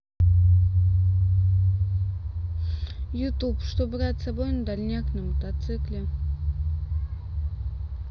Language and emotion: Russian, neutral